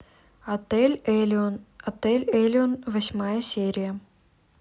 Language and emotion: Russian, neutral